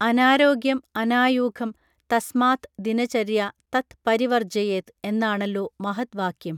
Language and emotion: Malayalam, neutral